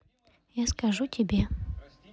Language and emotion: Russian, neutral